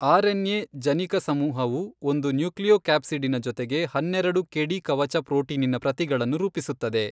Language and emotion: Kannada, neutral